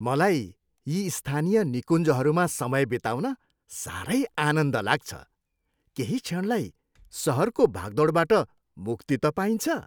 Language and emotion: Nepali, happy